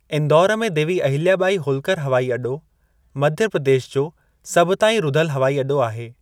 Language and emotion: Sindhi, neutral